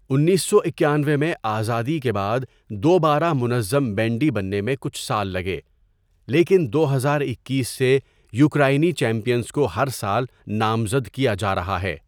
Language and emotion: Urdu, neutral